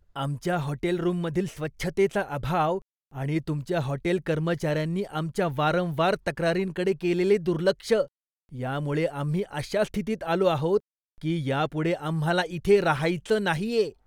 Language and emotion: Marathi, disgusted